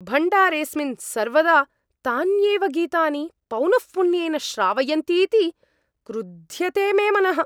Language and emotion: Sanskrit, angry